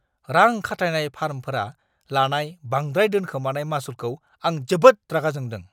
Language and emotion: Bodo, angry